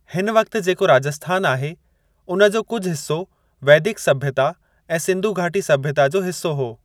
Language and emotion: Sindhi, neutral